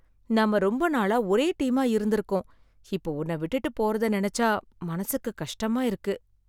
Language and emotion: Tamil, sad